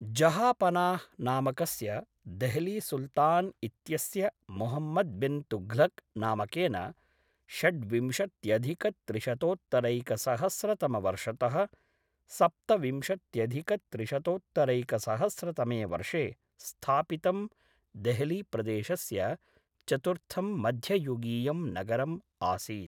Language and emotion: Sanskrit, neutral